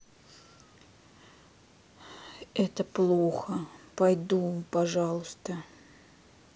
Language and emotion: Russian, sad